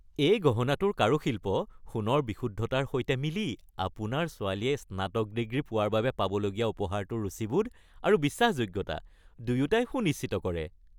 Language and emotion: Assamese, happy